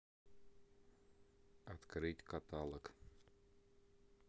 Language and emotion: Russian, neutral